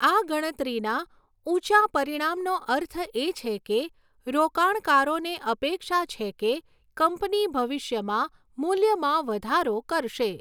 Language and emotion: Gujarati, neutral